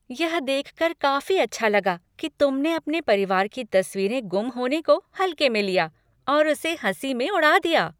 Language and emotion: Hindi, happy